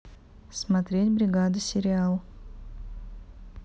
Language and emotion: Russian, neutral